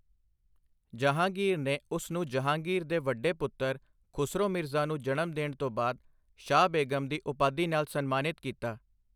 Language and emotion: Punjabi, neutral